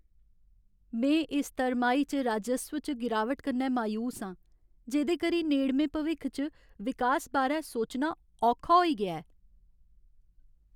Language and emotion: Dogri, sad